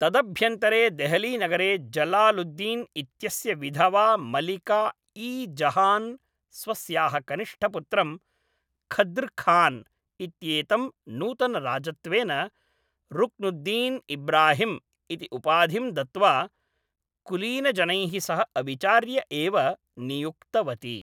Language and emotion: Sanskrit, neutral